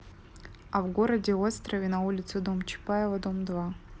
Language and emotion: Russian, neutral